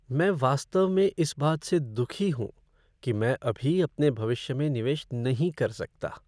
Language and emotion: Hindi, sad